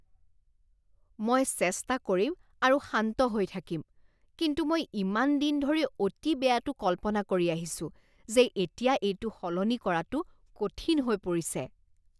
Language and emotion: Assamese, disgusted